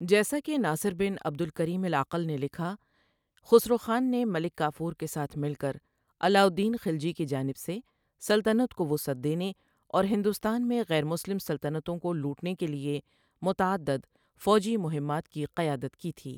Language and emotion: Urdu, neutral